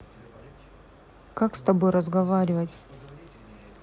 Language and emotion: Russian, neutral